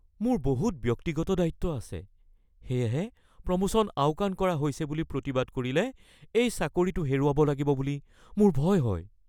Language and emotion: Assamese, fearful